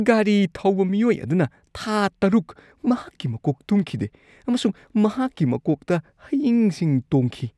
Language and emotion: Manipuri, disgusted